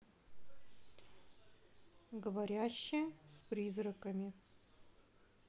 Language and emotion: Russian, neutral